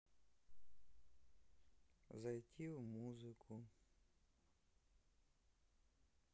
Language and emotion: Russian, sad